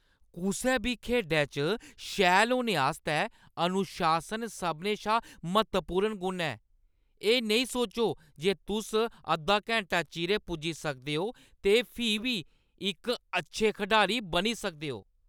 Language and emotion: Dogri, angry